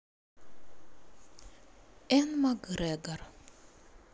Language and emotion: Russian, neutral